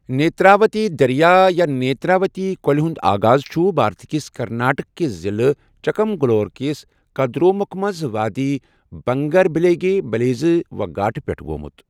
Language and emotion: Kashmiri, neutral